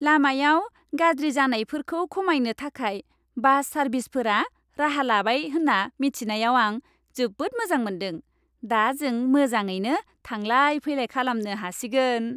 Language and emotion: Bodo, happy